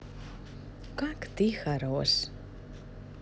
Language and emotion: Russian, positive